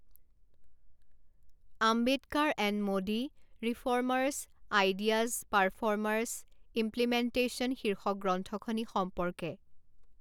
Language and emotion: Assamese, neutral